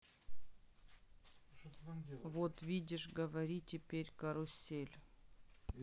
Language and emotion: Russian, neutral